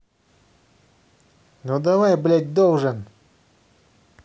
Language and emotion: Russian, angry